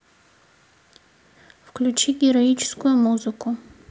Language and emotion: Russian, neutral